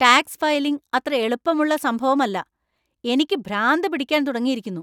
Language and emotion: Malayalam, angry